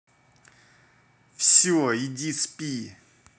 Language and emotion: Russian, angry